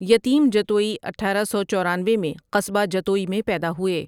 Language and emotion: Urdu, neutral